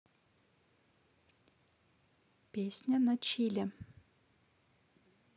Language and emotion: Russian, neutral